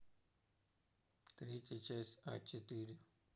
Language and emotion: Russian, neutral